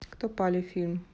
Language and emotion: Russian, neutral